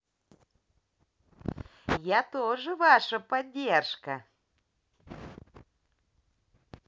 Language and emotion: Russian, positive